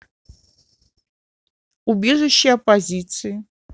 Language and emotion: Russian, neutral